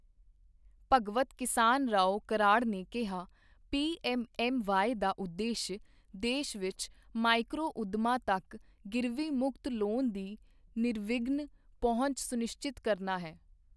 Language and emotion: Punjabi, neutral